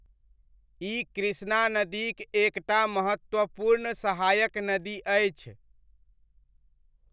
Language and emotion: Maithili, neutral